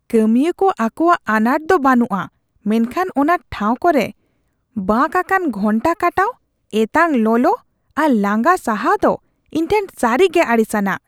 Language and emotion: Santali, disgusted